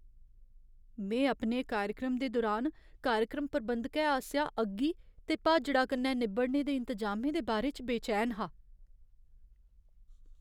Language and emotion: Dogri, fearful